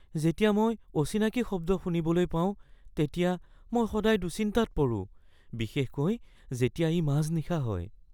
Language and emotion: Assamese, fearful